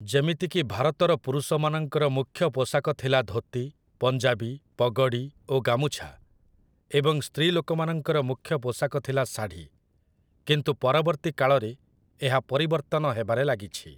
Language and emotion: Odia, neutral